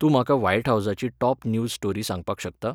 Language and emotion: Goan Konkani, neutral